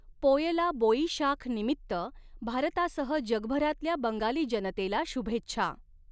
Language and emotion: Marathi, neutral